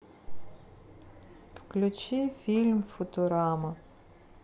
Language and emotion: Russian, sad